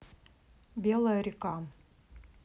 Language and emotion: Russian, neutral